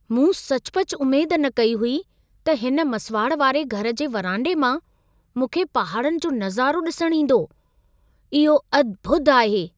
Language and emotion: Sindhi, surprised